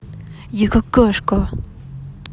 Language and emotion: Russian, angry